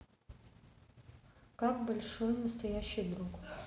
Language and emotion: Russian, neutral